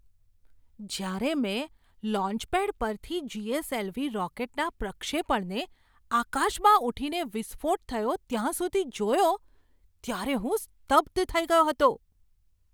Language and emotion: Gujarati, surprised